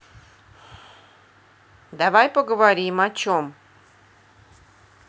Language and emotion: Russian, neutral